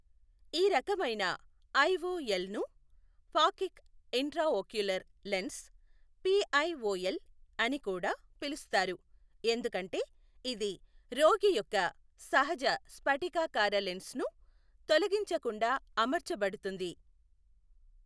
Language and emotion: Telugu, neutral